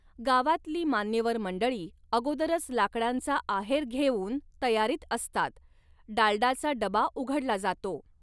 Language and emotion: Marathi, neutral